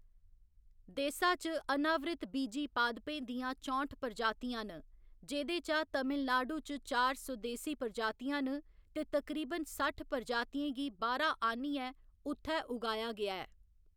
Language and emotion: Dogri, neutral